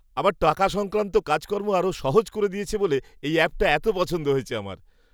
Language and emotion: Bengali, happy